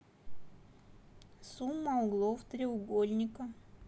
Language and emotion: Russian, neutral